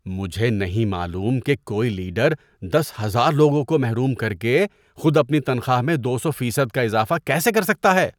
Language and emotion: Urdu, disgusted